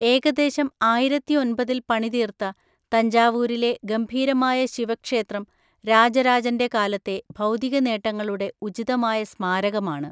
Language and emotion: Malayalam, neutral